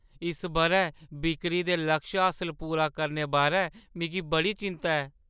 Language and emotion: Dogri, fearful